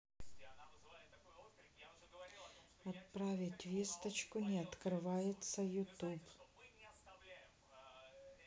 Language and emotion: Russian, neutral